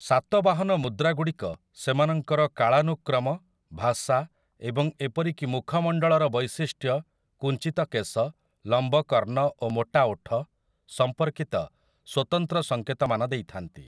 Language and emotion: Odia, neutral